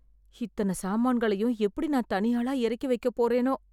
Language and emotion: Tamil, fearful